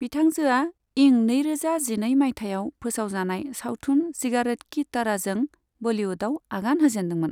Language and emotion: Bodo, neutral